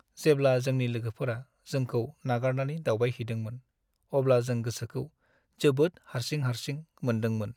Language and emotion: Bodo, sad